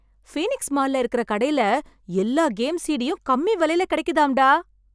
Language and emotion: Tamil, happy